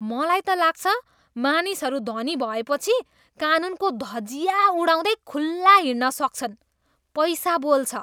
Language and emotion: Nepali, disgusted